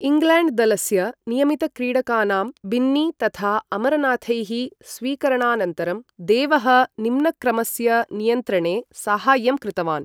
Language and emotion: Sanskrit, neutral